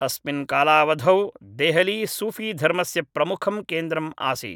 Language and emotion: Sanskrit, neutral